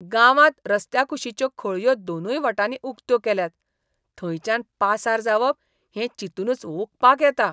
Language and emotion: Goan Konkani, disgusted